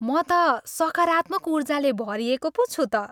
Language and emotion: Nepali, happy